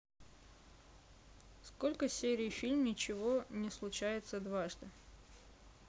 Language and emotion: Russian, neutral